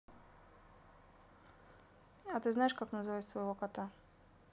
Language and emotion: Russian, neutral